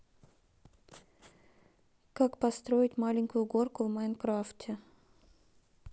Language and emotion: Russian, neutral